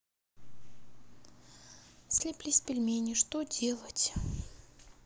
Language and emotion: Russian, sad